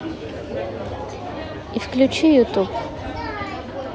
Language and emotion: Russian, neutral